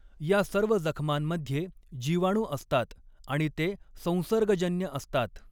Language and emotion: Marathi, neutral